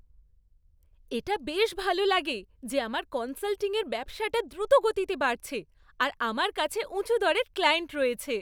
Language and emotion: Bengali, happy